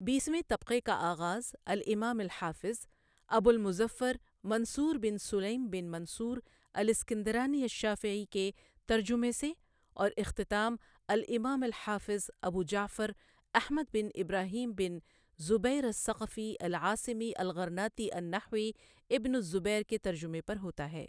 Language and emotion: Urdu, neutral